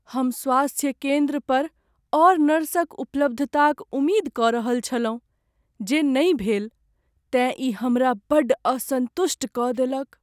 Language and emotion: Maithili, sad